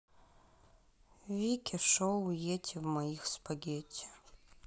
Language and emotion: Russian, sad